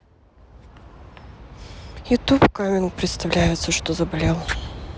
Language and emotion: Russian, sad